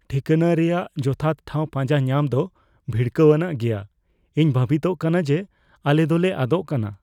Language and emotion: Santali, fearful